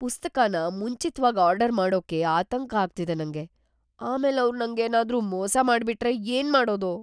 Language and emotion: Kannada, fearful